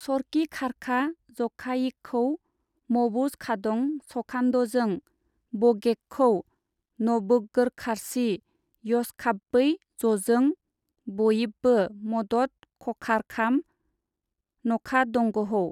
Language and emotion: Bodo, neutral